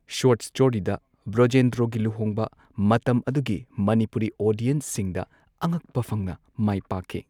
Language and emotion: Manipuri, neutral